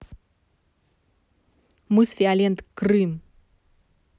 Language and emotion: Russian, angry